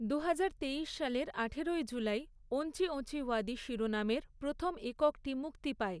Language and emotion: Bengali, neutral